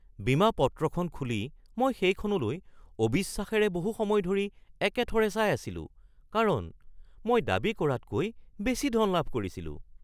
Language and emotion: Assamese, surprised